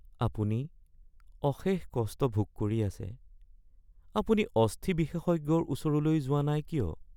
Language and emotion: Assamese, sad